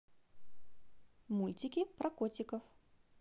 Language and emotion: Russian, positive